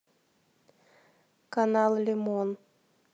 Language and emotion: Russian, neutral